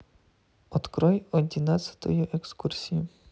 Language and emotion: Russian, neutral